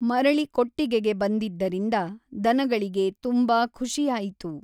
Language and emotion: Kannada, neutral